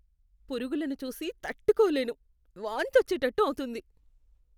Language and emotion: Telugu, disgusted